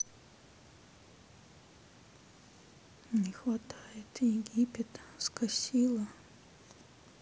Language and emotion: Russian, sad